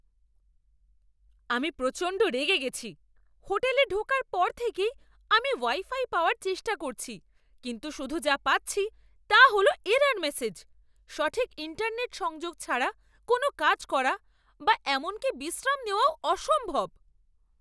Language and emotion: Bengali, angry